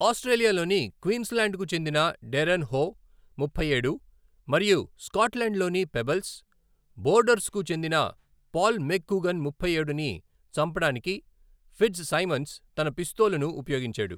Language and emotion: Telugu, neutral